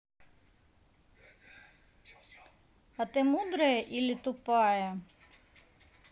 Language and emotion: Russian, neutral